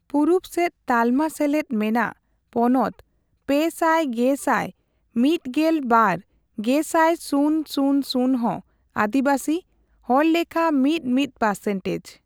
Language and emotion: Santali, neutral